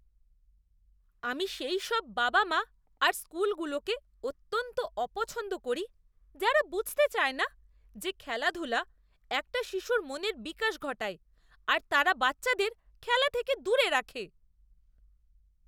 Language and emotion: Bengali, disgusted